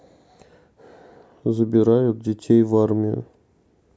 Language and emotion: Russian, neutral